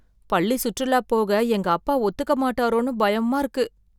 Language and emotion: Tamil, fearful